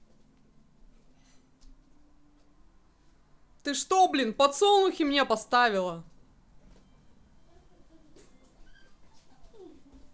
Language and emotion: Russian, angry